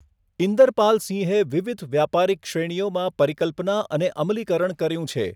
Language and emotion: Gujarati, neutral